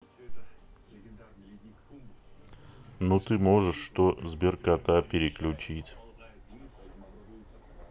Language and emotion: Russian, neutral